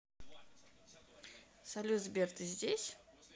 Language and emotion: Russian, neutral